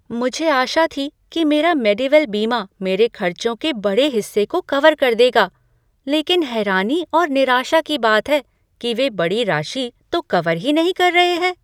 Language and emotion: Hindi, surprised